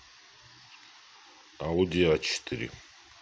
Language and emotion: Russian, neutral